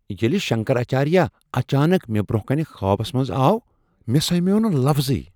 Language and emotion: Kashmiri, surprised